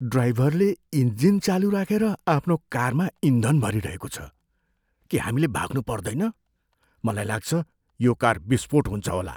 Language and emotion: Nepali, fearful